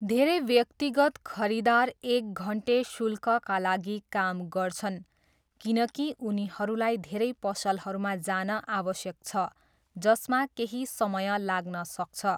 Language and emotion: Nepali, neutral